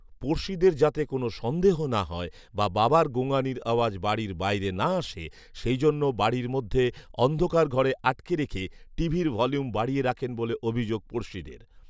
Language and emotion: Bengali, neutral